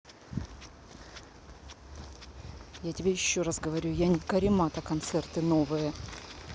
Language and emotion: Russian, angry